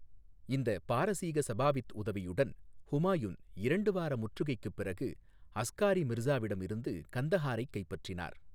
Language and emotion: Tamil, neutral